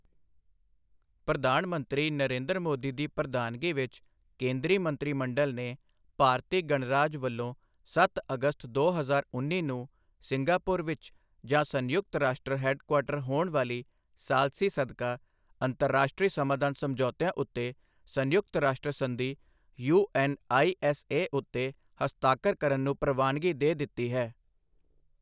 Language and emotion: Punjabi, neutral